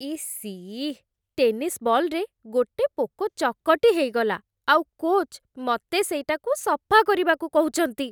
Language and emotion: Odia, disgusted